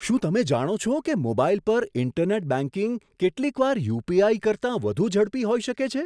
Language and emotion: Gujarati, surprised